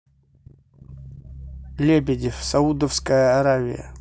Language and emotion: Russian, neutral